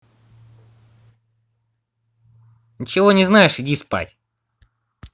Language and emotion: Russian, angry